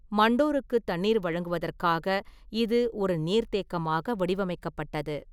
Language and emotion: Tamil, neutral